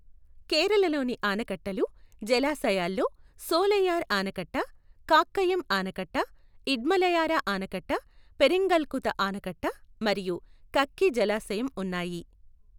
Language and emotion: Telugu, neutral